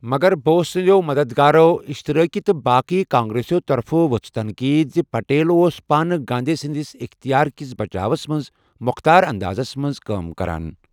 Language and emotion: Kashmiri, neutral